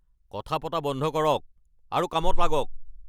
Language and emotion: Assamese, angry